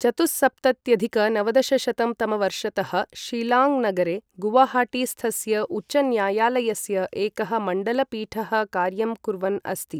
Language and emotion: Sanskrit, neutral